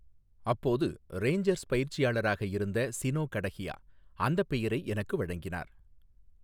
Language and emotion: Tamil, neutral